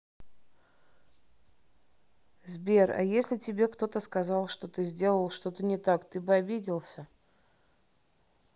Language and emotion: Russian, neutral